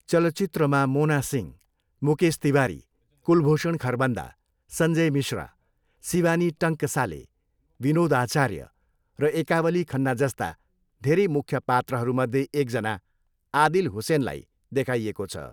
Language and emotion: Nepali, neutral